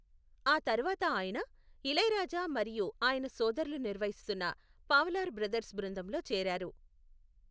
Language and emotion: Telugu, neutral